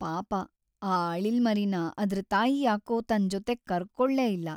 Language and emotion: Kannada, sad